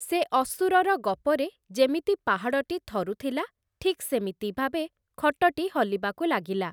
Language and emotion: Odia, neutral